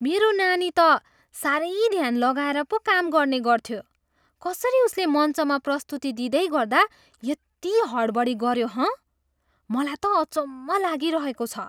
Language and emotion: Nepali, surprised